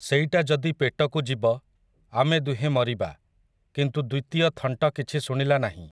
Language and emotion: Odia, neutral